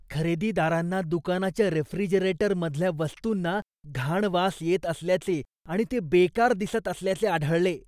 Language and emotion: Marathi, disgusted